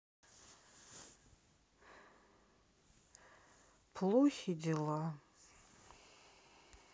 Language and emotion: Russian, sad